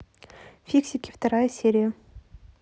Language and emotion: Russian, neutral